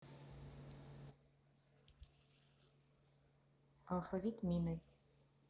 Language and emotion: Russian, neutral